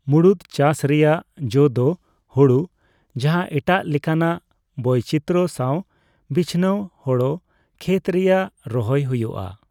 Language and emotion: Santali, neutral